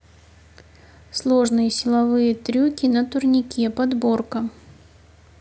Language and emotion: Russian, neutral